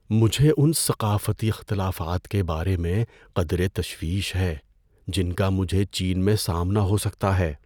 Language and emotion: Urdu, fearful